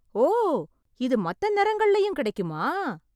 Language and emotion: Tamil, surprised